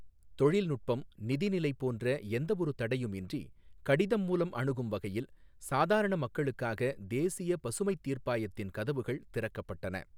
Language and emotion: Tamil, neutral